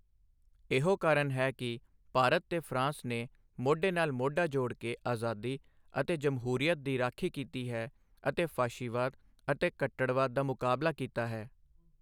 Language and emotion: Punjabi, neutral